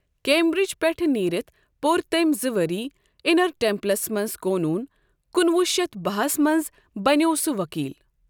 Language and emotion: Kashmiri, neutral